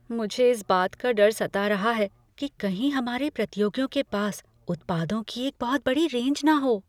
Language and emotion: Hindi, fearful